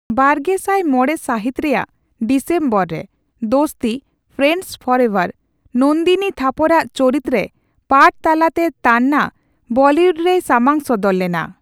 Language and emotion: Santali, neutral